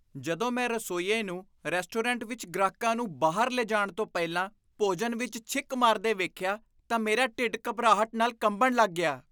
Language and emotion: Punjabi, disgusted